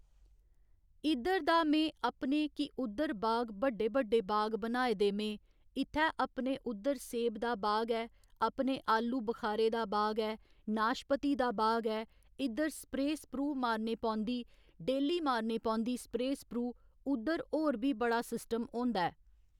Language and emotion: Dogri, neutral